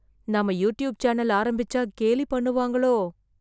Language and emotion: Tamil, fearful